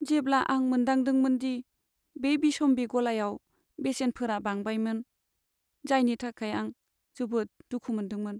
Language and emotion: Bodo, sad